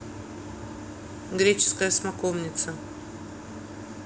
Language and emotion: Russian, neutral